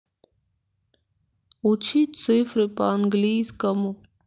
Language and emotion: Russian, sad